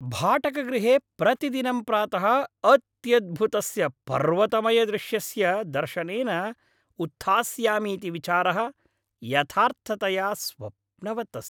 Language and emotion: Sanskrit, happy